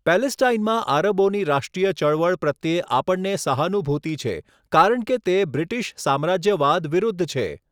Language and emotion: Gujarati, neutral